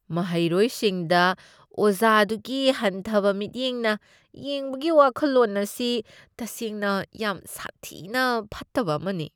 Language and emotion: Manipuri, disgusted